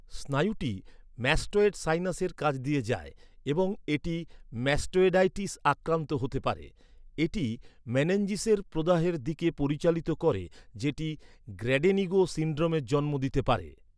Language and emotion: Bengali, neutral